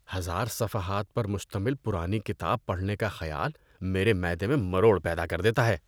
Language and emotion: Urdu, disgusted